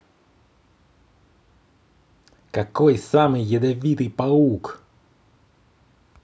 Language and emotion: Russian, positive